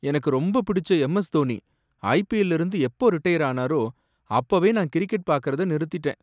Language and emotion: Tamil, sad